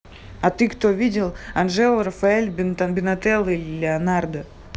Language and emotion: Russian, neutral